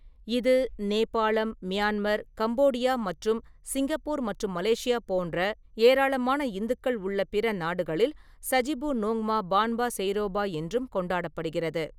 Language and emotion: Tamil, neutral